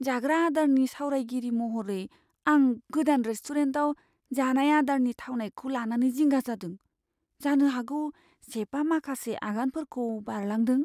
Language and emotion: Bodo, fearful